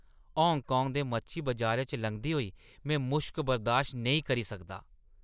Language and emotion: Dogri, disgusted